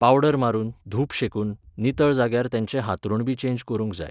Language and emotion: Goan Konkani, neutral